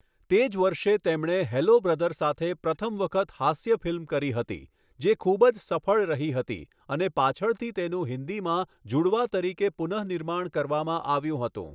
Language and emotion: Gujarati, neutral